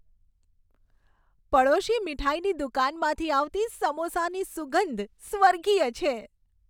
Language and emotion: Gujarati, happy